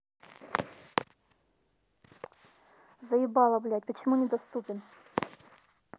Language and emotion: Russian, angry